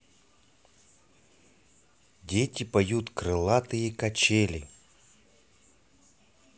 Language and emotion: Russian, neutral